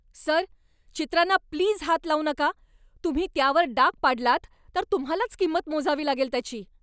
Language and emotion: Marathi, angry